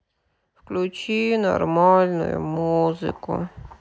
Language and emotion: Russian, sad